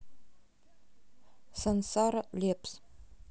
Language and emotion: Russian, neutral